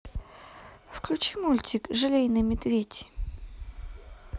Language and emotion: Russian, neutral